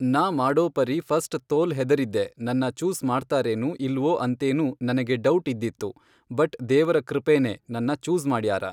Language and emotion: Kannada, neutral